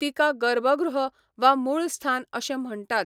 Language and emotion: Goan Konkani, neutral